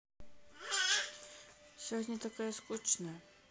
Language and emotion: Russian, sad